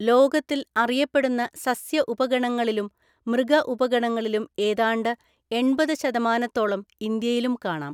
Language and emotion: Malayalam, neutral